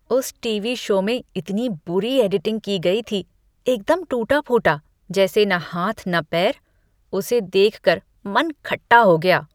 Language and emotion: Hindi, disgusted